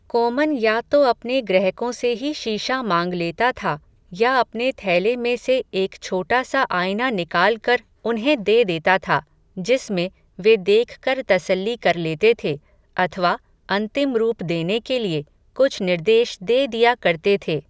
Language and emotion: Hindi, neutral